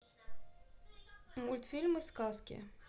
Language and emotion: Russian, neutral